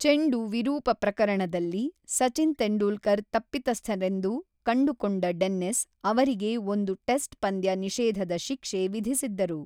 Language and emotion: Kannada, neutral